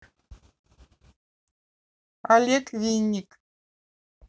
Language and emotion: Russian, neutral